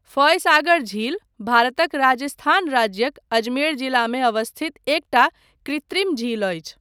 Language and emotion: Maithili, neutral